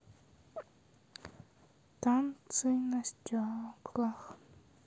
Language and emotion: Russian, sad